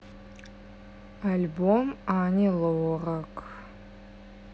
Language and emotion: Russian, neutral